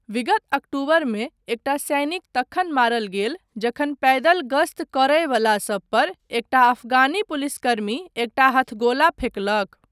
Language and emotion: Maithili, neutral